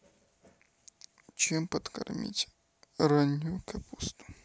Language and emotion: Russian, neutral